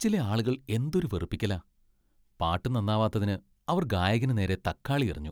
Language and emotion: Malayalam, disgusted